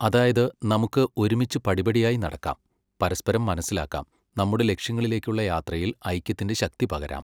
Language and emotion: Malayalam, neutral